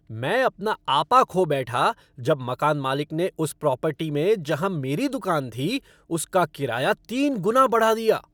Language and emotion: Hindi, angry